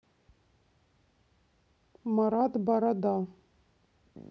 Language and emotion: Russian, neutral